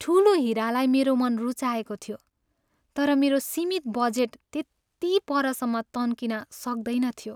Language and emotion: Nepali, sad